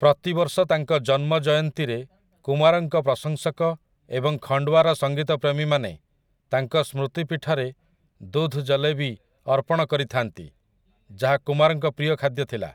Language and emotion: Odia, neutral